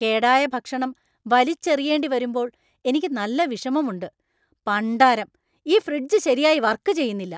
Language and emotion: Malayalam, angry